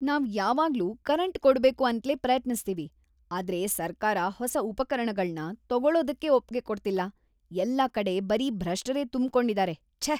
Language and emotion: Kannada, disgusted